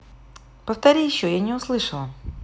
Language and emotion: Russian, neutral